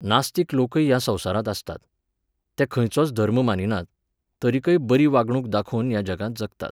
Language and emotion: Goan Konkani, neutral